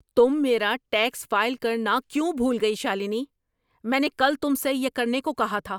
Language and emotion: Urdu, angry